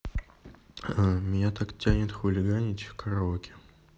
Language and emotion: Russian, neutral